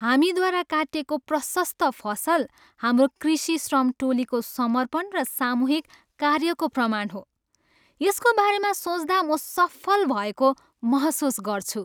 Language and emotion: Nepali, happy